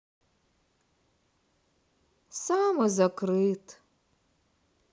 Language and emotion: Russian, sad